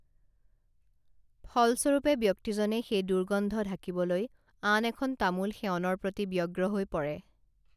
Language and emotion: Assamese, neutral